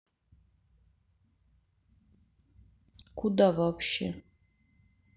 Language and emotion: Russian, sad